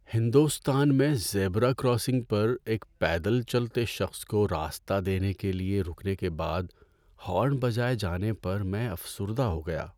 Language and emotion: Urdu, sad